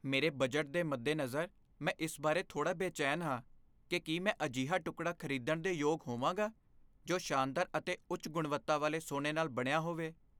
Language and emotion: Punjabi, fearful